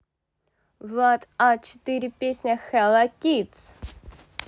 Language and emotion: Russian, positive